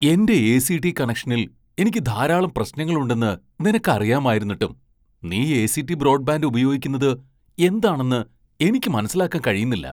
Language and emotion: Malayalam, surprised